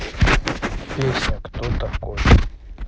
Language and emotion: Russian, neutral